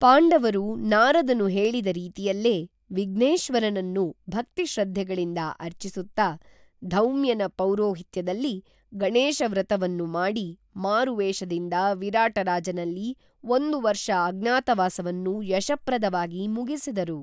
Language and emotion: Kannada, neutral